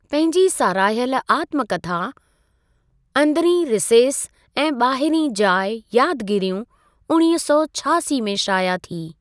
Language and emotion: Sindhi, neutral